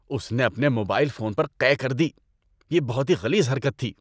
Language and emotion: Urdu, disgusted